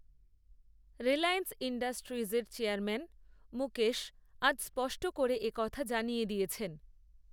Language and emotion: Bengali, neutral